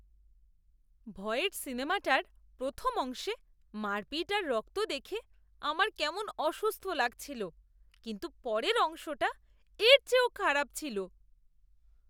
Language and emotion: Bengali, disgusted